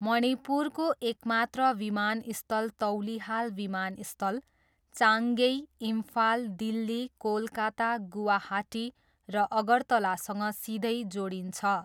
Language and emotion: Nepali, neutral